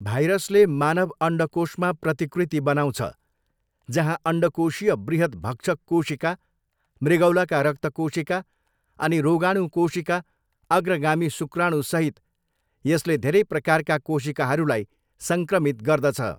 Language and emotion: Nepali, neutral